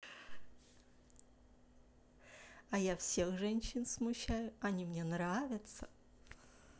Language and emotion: Russian, positive